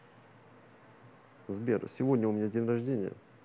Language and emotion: Russian, neutral